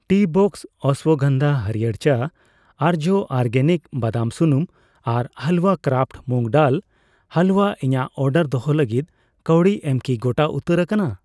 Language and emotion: Santali, neutral